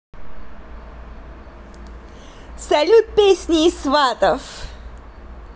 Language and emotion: Russian, positive